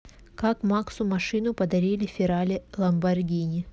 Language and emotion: Russian, neutral